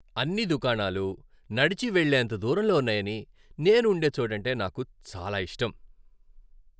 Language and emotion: Telugu, happy